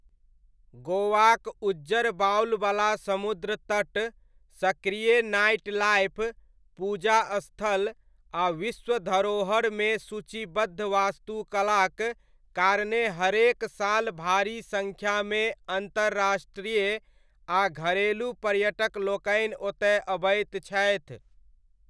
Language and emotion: Maithili, neutral